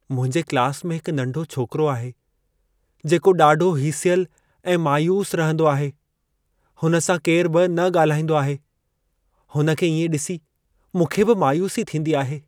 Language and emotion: Sindhi, sad